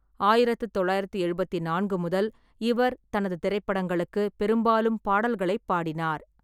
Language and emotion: Tamil, neutral